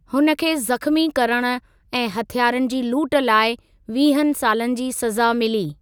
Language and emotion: Sindhi, neutral